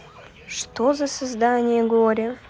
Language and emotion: Russian, sad